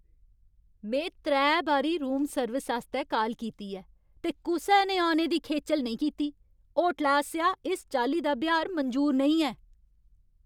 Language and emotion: Dogri, angry